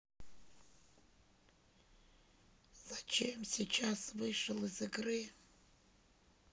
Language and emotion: Russian, sad